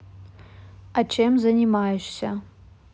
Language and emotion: Russian, neutral